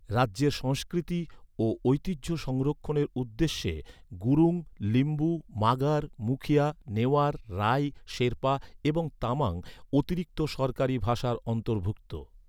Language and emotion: Bengali, neutral